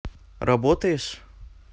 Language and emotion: Russian, neutral